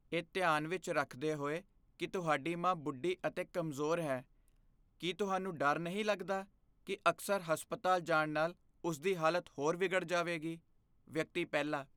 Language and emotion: Punjabi, fearful